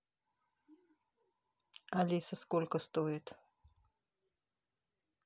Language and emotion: Russian, neutral